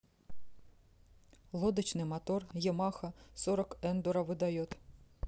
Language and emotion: Russian, neutral